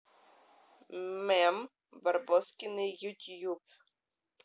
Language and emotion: Russian, neutral